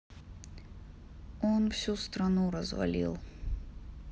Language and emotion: Russian, sad